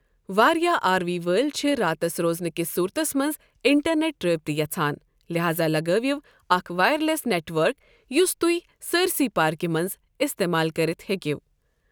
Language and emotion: Kashmiri, neutral